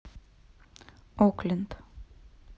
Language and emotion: Russian, neutral